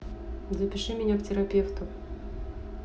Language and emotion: Russian, neutral